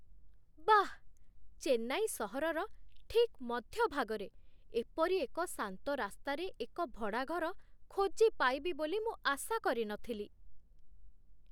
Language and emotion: Odia, surprised